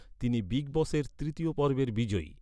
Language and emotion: Bengali, neutral